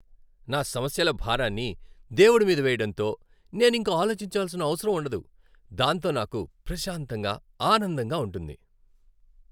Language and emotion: Telugu, happy